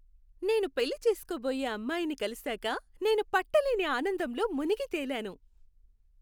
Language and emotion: Telugu, happy